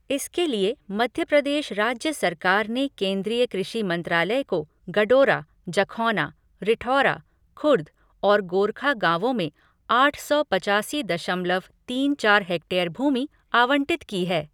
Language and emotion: Hindi, neutral